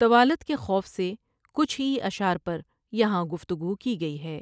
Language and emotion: Urdu, neutral